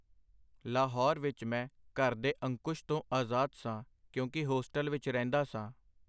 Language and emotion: Punjabi, neutral